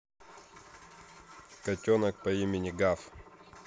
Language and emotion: Russian, neutral